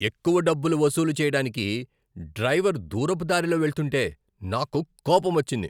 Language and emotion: Telugu, angry